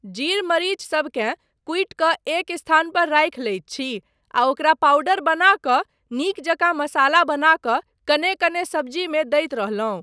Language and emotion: Maithili, neutral